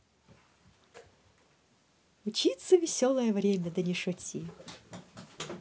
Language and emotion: Russian, positive